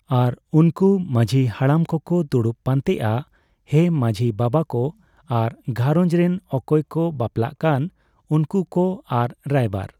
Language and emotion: Santali, neutral